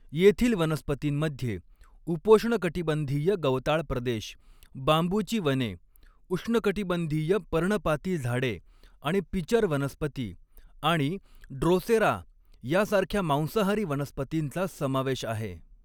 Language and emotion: Marathi, neutral